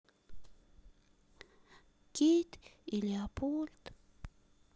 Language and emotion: Russian, sad